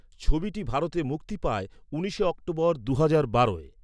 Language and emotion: Bengali, neutral